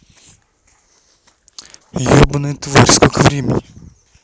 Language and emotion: Russian, angry